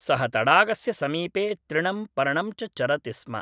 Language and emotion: Sanskrit, neutral